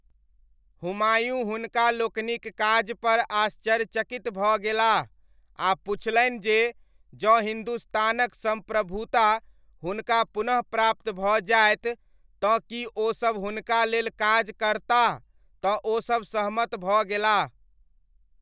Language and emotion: Maithili, neutral